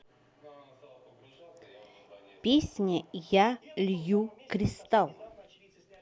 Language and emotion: Russian, neutral